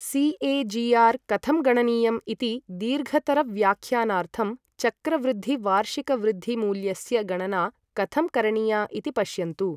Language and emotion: Sanskrit, neutral